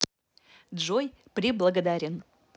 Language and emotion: Russian, positive